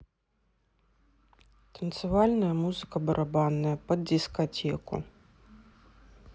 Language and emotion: Russian, neutral